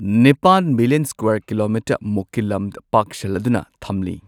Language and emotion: Manipuri, neutral